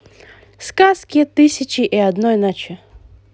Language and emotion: Russian, positive